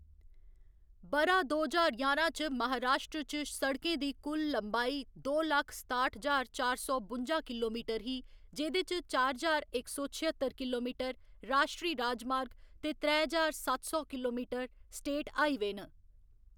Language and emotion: Dogri, neutral